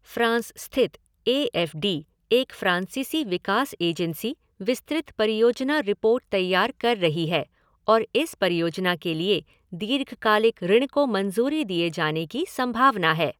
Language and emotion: Hindi, neutral